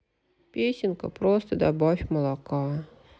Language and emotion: Russian, sad